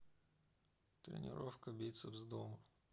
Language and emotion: Russian, sad